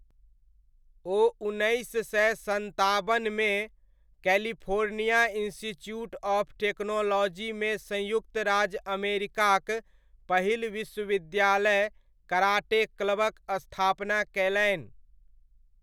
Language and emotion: Maithili, neutral